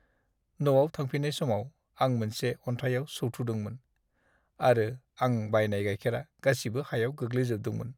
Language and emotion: Bodo, sad